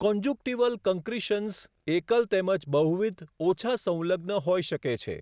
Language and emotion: Gujarati, neutral